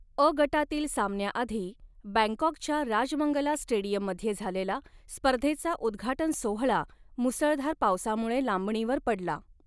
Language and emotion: Marathi, neutral